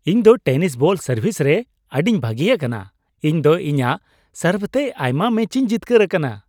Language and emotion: Santali, happy